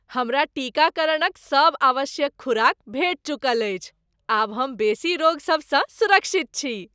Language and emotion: Maithili, happy